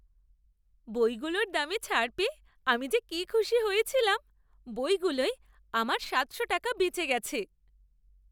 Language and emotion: Bengali, happy